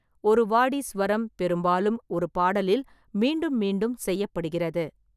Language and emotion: Tamil, neutral